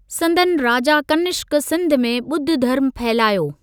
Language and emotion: Sindhi, neutral